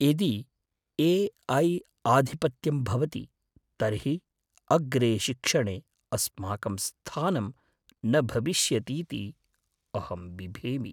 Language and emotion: Sanskrit, fearful